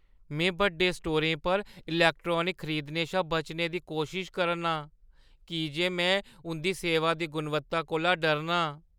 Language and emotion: Dogri, fearful